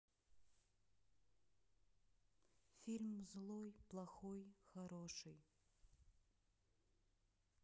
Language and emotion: Russian, sad